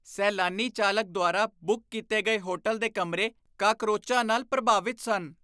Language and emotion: Punjabi, disgusted